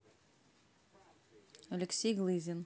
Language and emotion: Russian, neutral